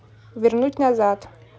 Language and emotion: Russian, neutral